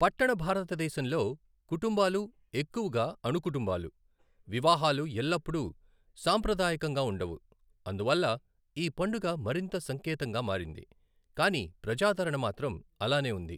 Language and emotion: Telugu, neutral